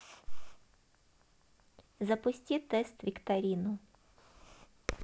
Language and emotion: Russian, neutral